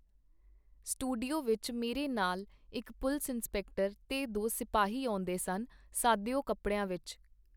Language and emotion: Punjabi, neutral